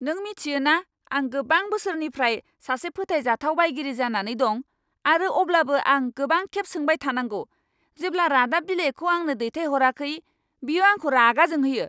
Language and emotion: Bodo, angry